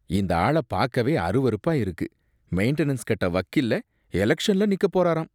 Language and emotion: Tamil, disgusted